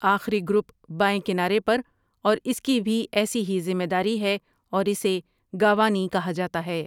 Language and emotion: Urdu, neutral